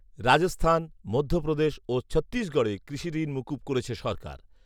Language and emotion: Bengali, neutral